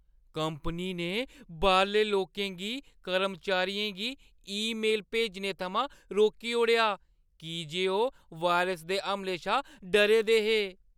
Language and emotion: Dogri, fearful